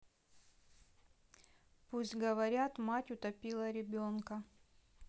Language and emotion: Russian, neutral